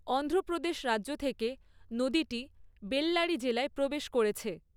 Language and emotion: Bengali, neutral